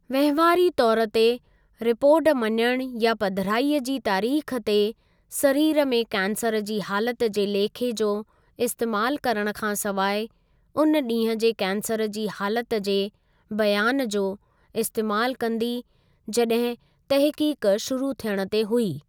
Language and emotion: Sindhi, neutral